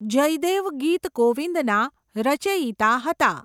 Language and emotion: Gujarati, neutral